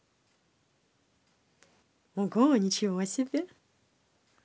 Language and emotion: Russian, positive